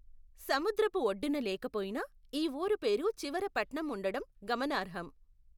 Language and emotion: Telugu, neutral